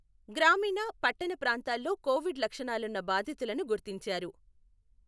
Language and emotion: Telugu, neutral